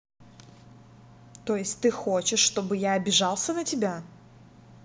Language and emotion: Russian, angry